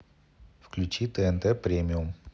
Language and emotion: Russian, neutral